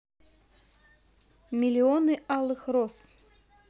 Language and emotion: Russian, neutral